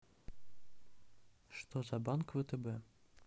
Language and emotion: Russian, neutral